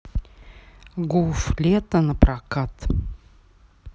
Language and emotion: Russian, neutral